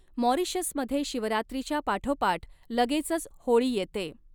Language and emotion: Marathi, neutral